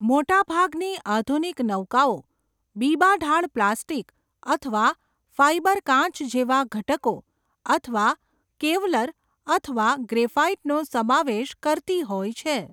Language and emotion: Gujarati, neutral